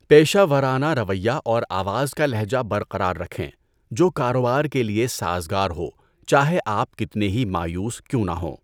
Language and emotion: Urdu, neutral